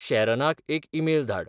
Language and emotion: Goan Konkani, neutral